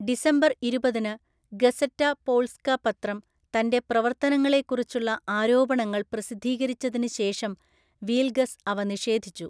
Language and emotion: Malayalam, neutral